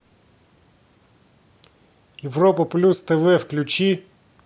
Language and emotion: Russian, angry